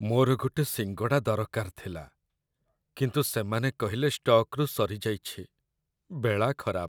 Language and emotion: Odia, sad